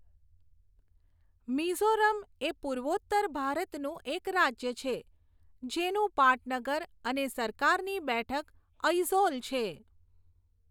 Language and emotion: Gujarati, neutral